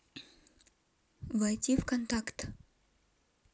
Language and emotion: Russian, neutral